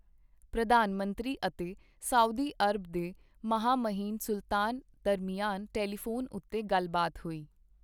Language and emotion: Punjabi, neutral